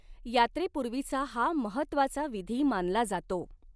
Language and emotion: Marathi, neutral